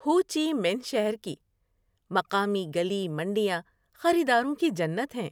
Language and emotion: Urdu, happy